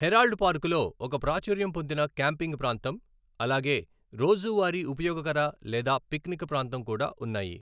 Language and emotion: Telugu, neutral